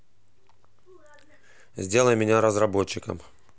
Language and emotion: Russian, neutral